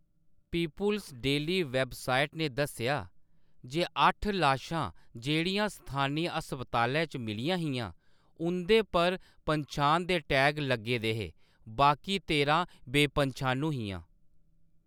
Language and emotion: Dogri, neutral